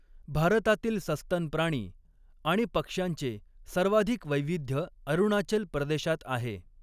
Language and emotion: Marathi, neutral